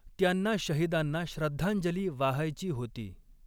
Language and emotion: Marathi, neutral